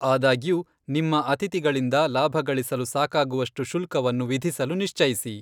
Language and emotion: Kannada, neutral